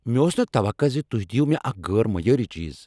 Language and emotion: Kashmiri, angry